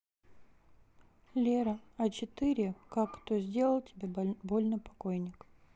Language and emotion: Russian, neutral